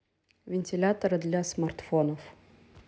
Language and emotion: Russian, neutral